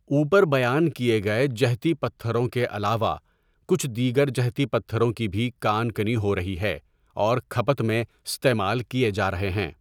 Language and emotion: Urdu, neutral